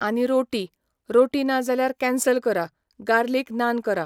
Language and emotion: Goan Konkani, neutral